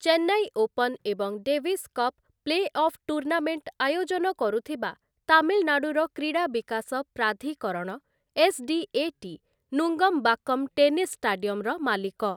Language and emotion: Odia, neutral